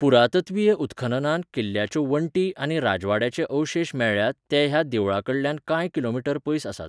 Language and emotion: Goan Konkani, neutral